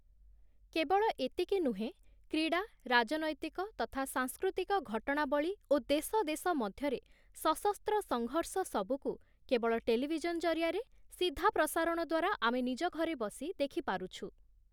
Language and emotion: Odia, neutral